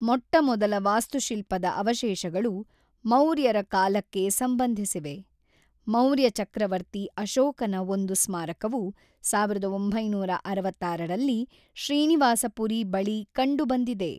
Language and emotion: Kannada, neutral